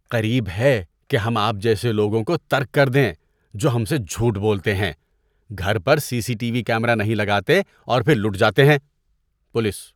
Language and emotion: Urdu, disgusted